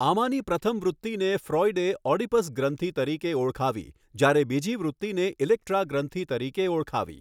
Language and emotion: Gujarati, neutral